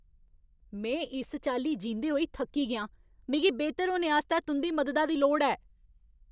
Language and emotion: Dogri, angry